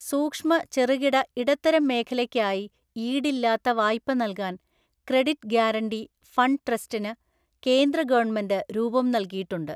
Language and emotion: Malayalam, neutral